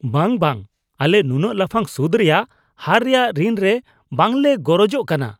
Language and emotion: Santali, disgusted